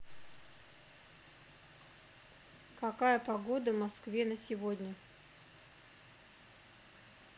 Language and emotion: Russian, neutral